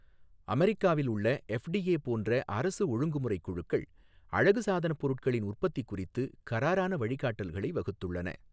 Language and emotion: Tamil, neutral